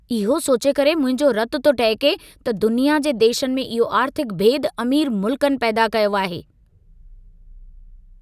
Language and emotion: Sindhi, angry